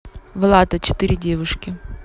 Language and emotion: Russian, neutral